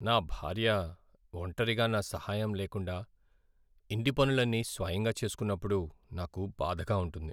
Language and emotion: Telugu, sad